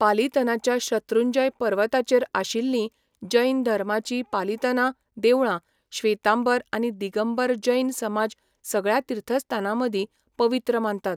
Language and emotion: Goan Konkani, neutral